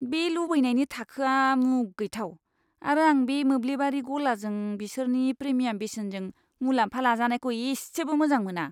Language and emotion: Bodo, disgusted